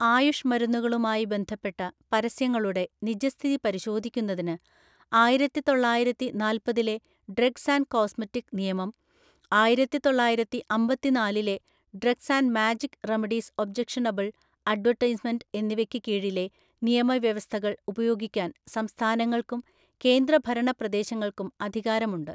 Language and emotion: Malayalam, neutral